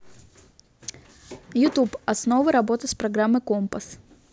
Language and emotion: Russian, neutral